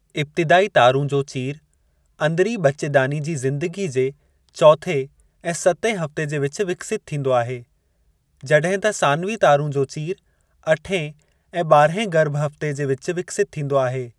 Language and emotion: Sindhi, neutral